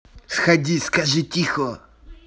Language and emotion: Russian, angry